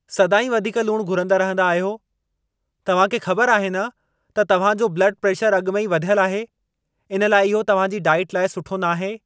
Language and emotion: Sindhi, angry